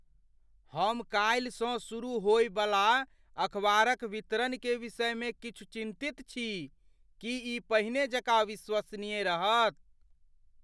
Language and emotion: Maithili, fearful